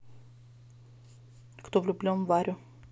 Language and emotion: Russian, neutral